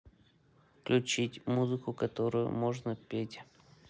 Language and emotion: Russian, neutral